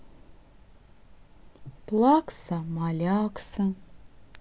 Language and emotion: Russian, sad